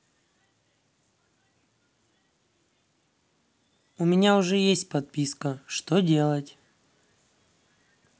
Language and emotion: Russian, neutral